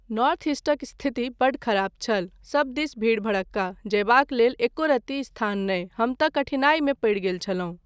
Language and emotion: Maithili, neutral